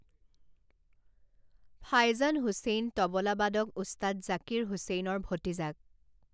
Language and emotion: Assamese, neutral